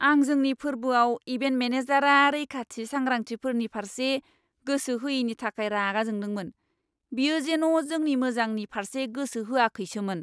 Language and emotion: Bodo, angry